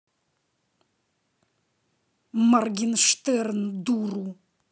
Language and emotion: Russian, angry